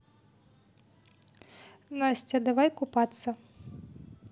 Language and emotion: Russian, neutral